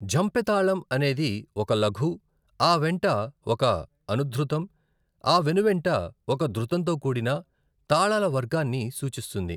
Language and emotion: Telugu, neutral